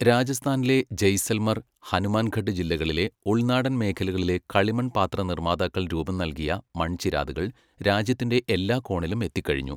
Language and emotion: Malayalam, neutral